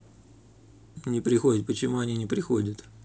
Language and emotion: Russian, neutral